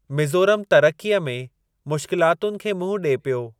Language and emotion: Sindhi, neutral